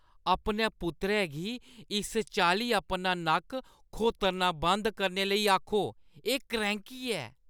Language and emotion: Dogri, disgusted